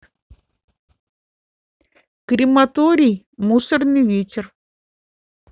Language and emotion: Russian, neutral